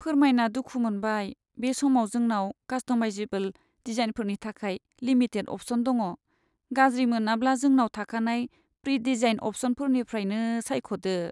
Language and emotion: Bodo, sad